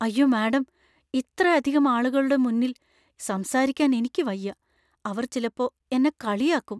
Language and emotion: Malayalam, fearful